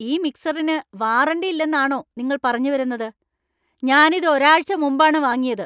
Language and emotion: Malayalam, angry